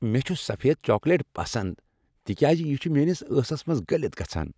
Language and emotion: Kashmiri, happy